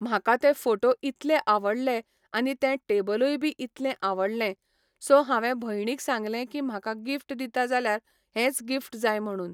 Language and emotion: Goan Konkani, neutral